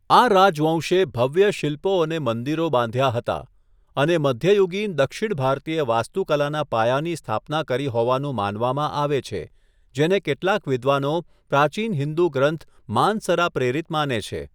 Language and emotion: Gujarati, neutral